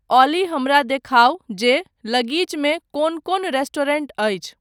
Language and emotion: Maithili, neutral